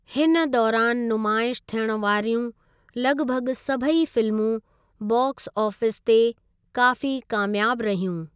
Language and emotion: Sindhi, neutral